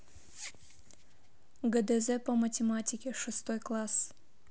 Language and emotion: Russian, neutral